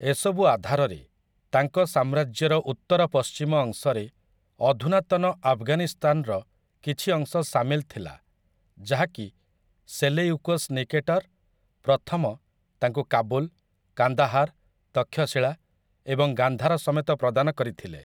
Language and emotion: Odia, neutral